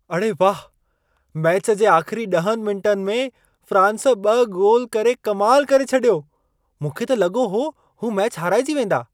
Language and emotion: Sindhi, surprised